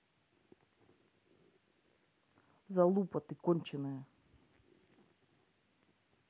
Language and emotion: Russian, angry